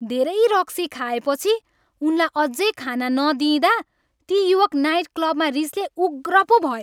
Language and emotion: Nepali, angry